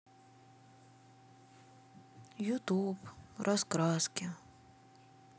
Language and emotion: Russian, sad